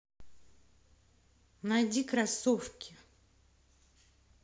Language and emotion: Russian, angry